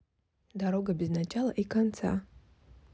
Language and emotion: Russian, neutral